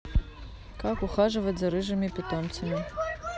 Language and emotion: Russian, neutral